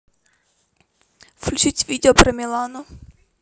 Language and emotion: Russian, neutral